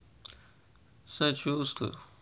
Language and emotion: Russian, sad